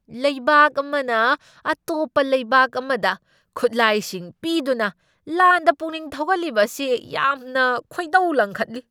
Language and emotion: Manipuri, angry